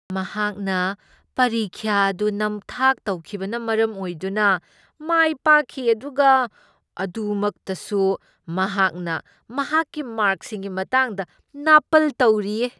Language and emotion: Manipuri, disgusted